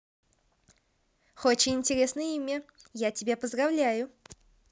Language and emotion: Russian, positive